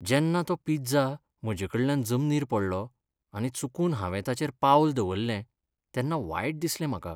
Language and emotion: Goan Konkani, sad